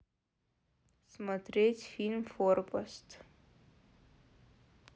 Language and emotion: Russian, neutral